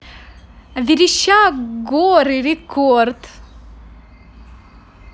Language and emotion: Russian, positive